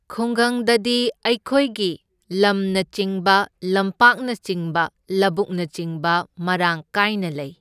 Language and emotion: Manipuri, neutral